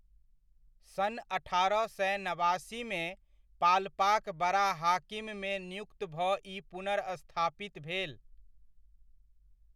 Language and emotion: Maithili, neutral